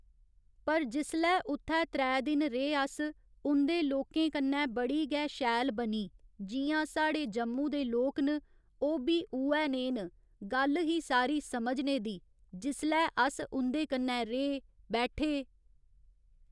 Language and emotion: Dogri, neutral